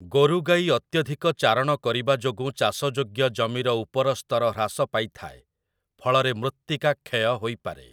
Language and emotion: Odia, neutral